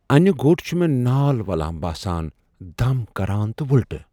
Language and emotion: Kashmiri, fearful